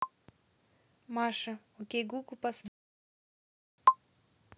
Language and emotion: Russian, neutral